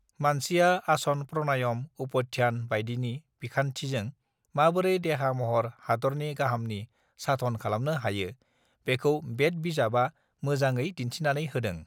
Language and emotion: Bodo, neutral